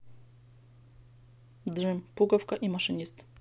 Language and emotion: Russian, neutral